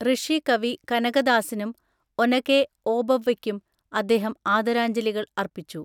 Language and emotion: Malayalam, neutral